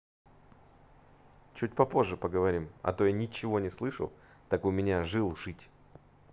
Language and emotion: Russian, neutral